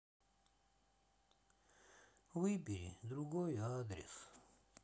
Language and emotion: Russian, sad